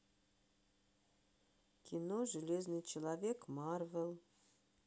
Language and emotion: Russian, neutral